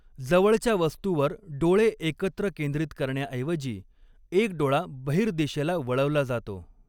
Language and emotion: Marathi, neutral